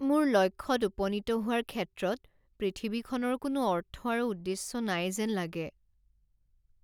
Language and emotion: Assamese, sad